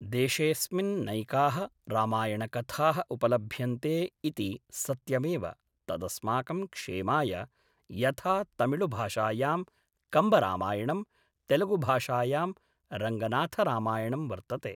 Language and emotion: Sanskrit, neutral